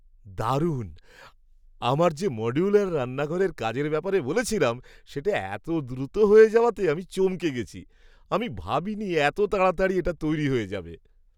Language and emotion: Bengali, surprised